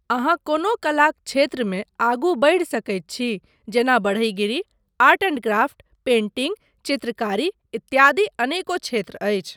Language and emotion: Maithili, neutral